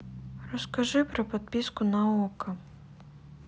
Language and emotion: Russian, neutral